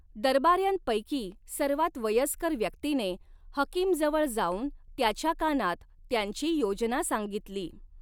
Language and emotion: Marathi, neutral